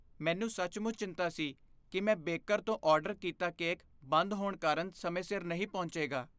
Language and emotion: Punjabi, fearful